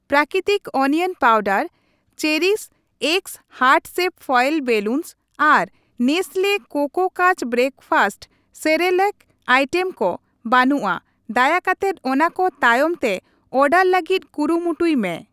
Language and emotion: Santali, neutral